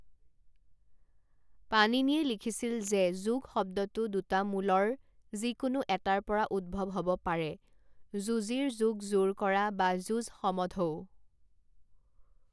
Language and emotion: Assamese, neutral